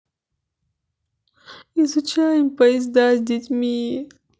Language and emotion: Russian, sad